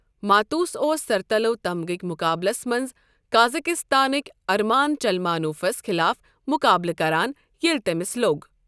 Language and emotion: Kashmiri, neutral